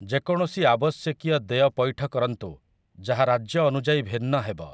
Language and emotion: Odia, neutral